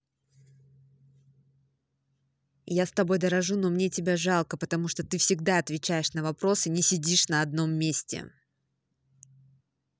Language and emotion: Russian, angry